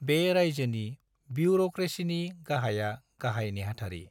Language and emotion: Bodo, neutral